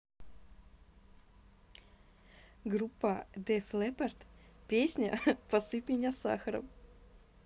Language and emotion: Russian, positive